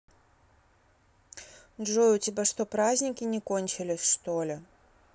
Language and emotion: Russian, neutral